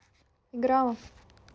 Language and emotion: Russian, neutral